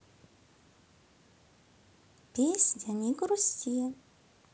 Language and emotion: Russian, positive